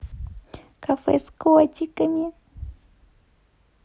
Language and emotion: Russian, positive